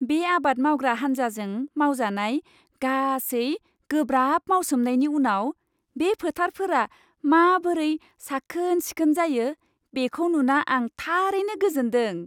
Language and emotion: Bodo, happy